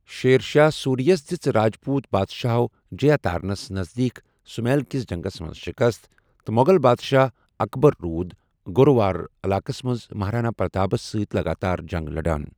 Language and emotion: Kashmiri, neutral